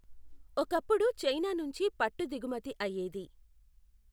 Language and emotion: Telugu, neutral